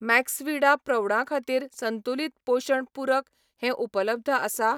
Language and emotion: Goan Konkani, neutral